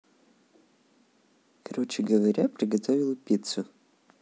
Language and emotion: Russian, neutral